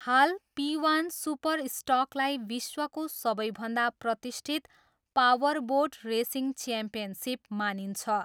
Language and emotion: Nepali, neutral